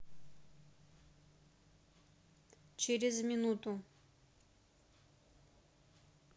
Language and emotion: Russian, neutral